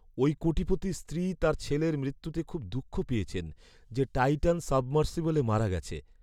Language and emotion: Bengali, sad